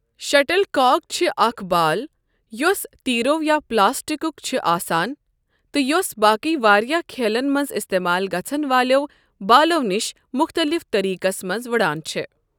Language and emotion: Kashmiri, neutral